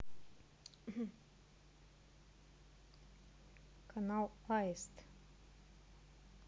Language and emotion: Russian, neutral